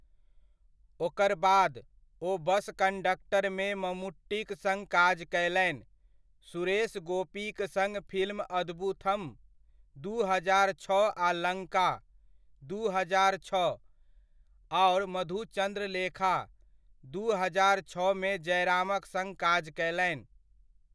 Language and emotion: Maithili, neutral